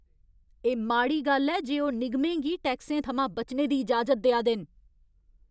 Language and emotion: Dogri, angry